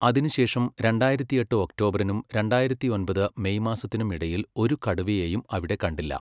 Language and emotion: Malayalam, neutral